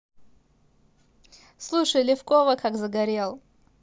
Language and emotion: Russian, positive